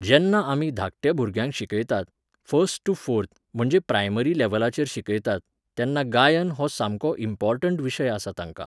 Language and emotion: Goan Konkani, neutral